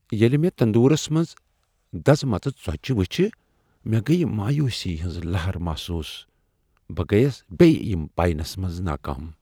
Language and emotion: Kashmiri, sad